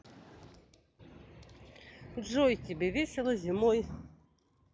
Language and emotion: Russian, positive